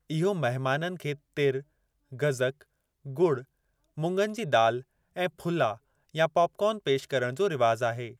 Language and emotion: Sindhi, neutral